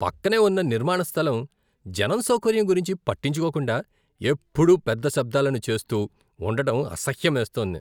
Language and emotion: Telugu, disgusted